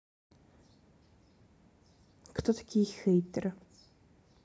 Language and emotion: Russian, neutral